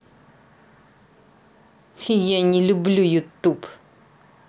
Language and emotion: Russian, angry